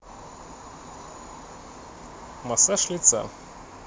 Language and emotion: Russian, neutral